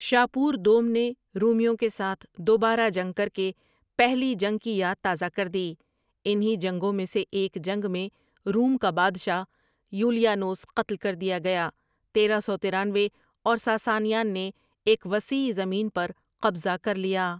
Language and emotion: Urdu, neutral